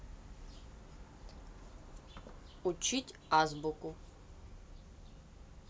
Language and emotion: Russian, neutral